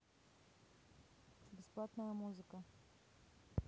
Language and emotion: Russian, neutral